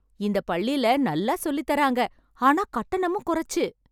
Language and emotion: Tamil, happy